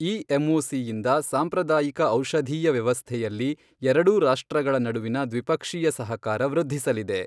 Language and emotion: Kannada, neutral